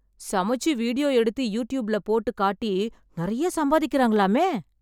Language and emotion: Tamil, surprised